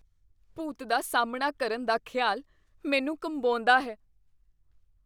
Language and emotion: Punjabi, fearful